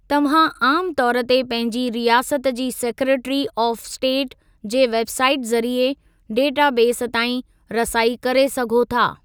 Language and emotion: Sindhi, neutral